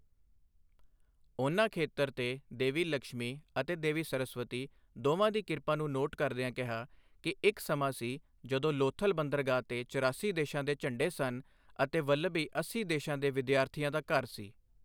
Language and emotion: Punjabi, neutral